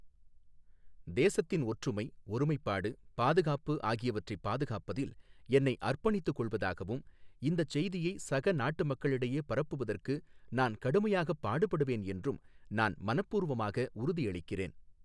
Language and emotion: Tamil, neutral